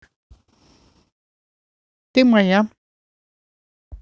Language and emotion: Russian, neutral